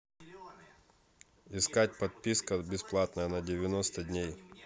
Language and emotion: Russian, neutral